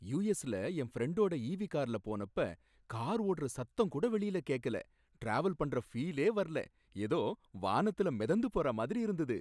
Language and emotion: Tamil, happy